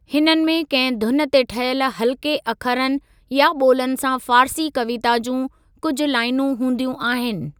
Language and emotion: Sindhi, neutral